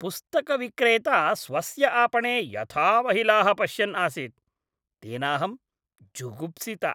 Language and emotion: Sanskrit, disgusted